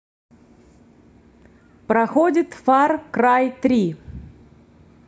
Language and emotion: Russian, neutral